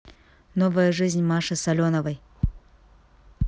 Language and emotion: Russian, neutral